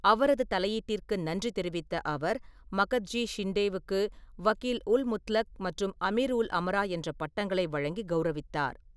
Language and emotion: Tamil, neutral